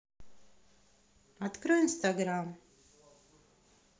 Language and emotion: Russian, neutral